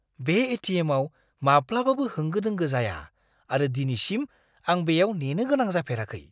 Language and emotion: Bodo, surprised